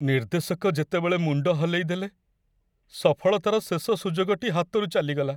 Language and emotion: Odia, sad